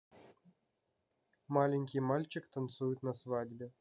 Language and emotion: Russian, neutral